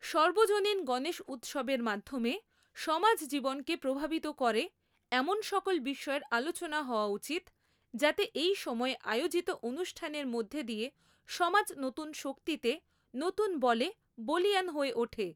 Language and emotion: Bengali, neutral